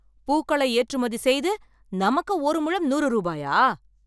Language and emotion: Tamil, angry